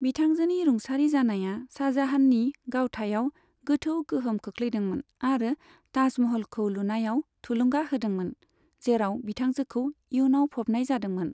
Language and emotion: Bodo, neutral